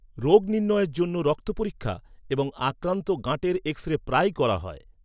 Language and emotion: Bengali, neutral